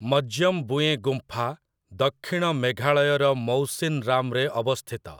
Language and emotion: Odia, neutral